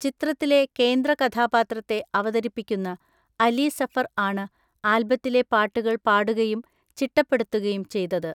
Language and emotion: Malayalam, neutral